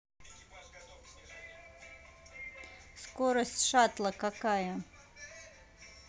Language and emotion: Russian, neutral